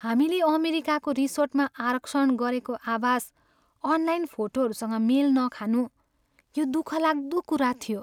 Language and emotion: Nepali, sad